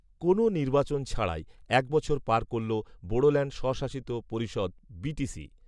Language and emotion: Bengali, neutral